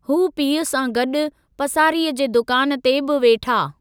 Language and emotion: Sindhi, neutral